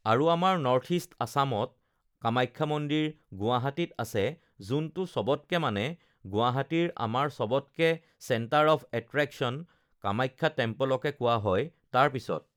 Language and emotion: Assamese, neutral